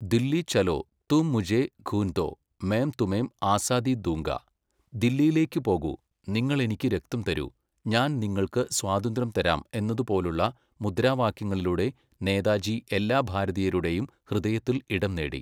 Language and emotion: Malayalam, neutral